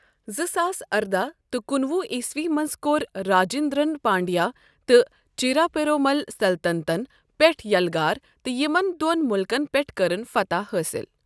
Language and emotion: Kashmiri, neutral